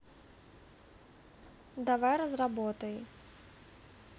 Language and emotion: Russian, neutral